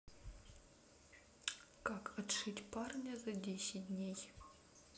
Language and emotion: Russian, neutral